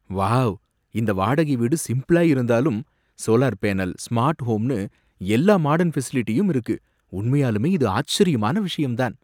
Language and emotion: Tamil, surprised